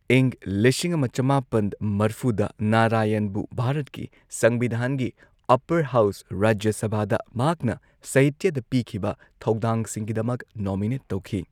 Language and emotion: Manipuri, neutral